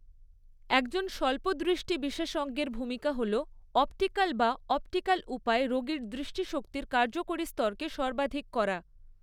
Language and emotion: Bengali, neutral